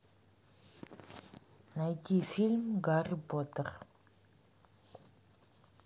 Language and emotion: Russian, neutral